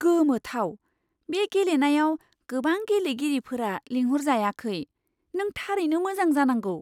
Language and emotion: Bodo, surprised